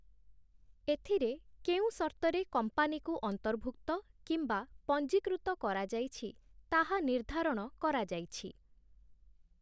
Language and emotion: Odia, neutral